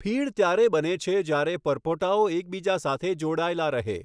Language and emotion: Gujarati, neutral